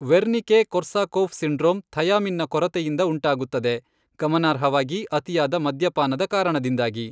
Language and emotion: Kannada, neutral